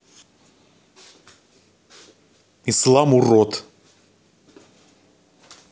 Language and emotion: Russian, angry